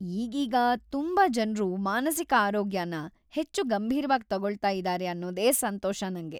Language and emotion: Kannada, happy